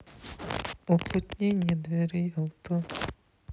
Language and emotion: Russian, sad